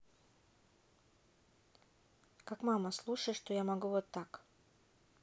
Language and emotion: Russian, neutral